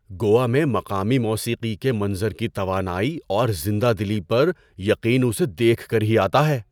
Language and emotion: Urdu, surprised